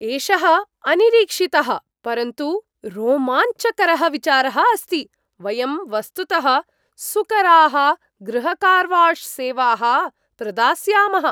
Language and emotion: Sanskrit, surprised